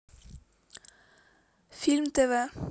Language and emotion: Russian, neutral